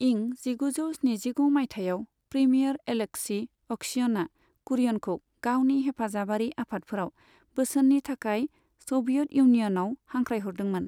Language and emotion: Bodo, neutral